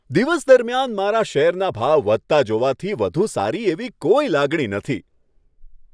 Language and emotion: Gujarati, happy